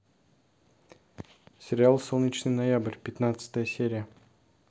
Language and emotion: Russian, neutral